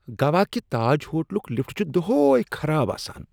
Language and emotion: Kashmiri, disgusted